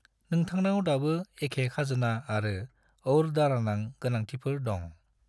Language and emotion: Bodo, neutral